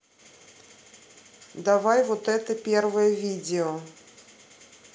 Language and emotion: Russian, neutral